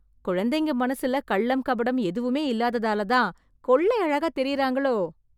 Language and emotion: Tamil, surprised